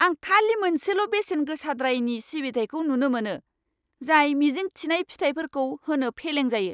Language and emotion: Bodo, angry